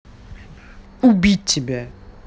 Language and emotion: Russian, angry